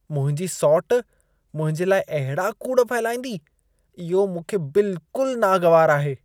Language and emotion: Sindhi, disgusted